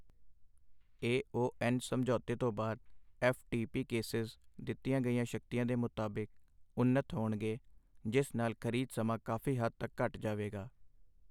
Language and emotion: Punjabi, neutral